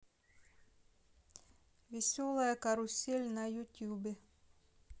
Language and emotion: Russian, neutral